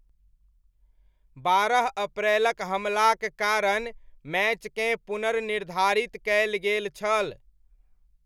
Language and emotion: Maithili, neutral